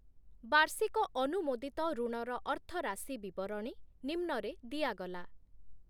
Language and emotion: Odia, neutral